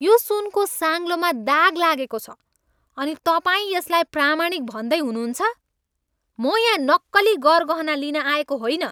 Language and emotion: Nepali, angry